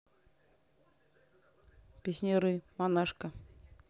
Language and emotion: Russian, neutral